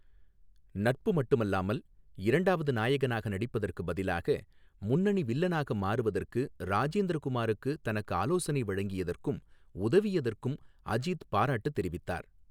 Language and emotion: Tamil, neutral